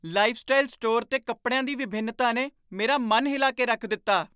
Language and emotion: Punjabi, surprised